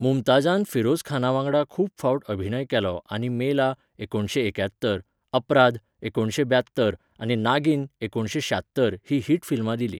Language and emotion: Goan Konkani, neutral